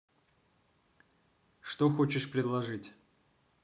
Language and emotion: Russian, neutral